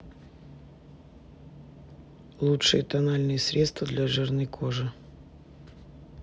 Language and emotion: Russian, neutral